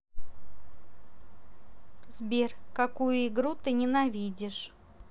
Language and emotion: Russian, neutral